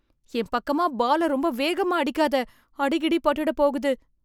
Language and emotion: Tamil, fearful